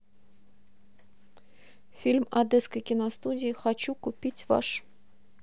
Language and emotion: Russian, neutral